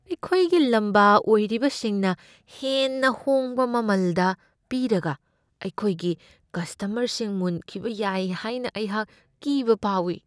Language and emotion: Manipuri, fearful